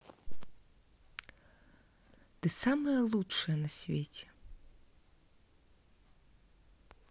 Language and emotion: Russian, positive